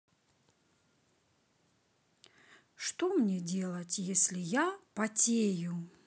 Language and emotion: Russian, sad